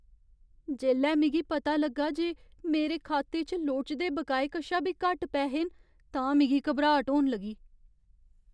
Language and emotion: Dogri, fearful